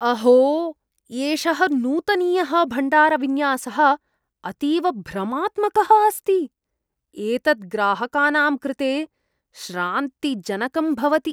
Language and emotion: Sanskrit, disgusted